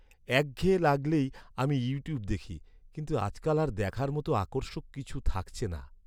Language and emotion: Bengali, sad